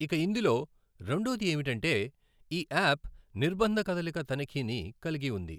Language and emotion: Telugu, neutral